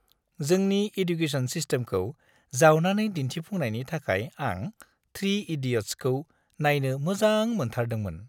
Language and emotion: Bodo, happy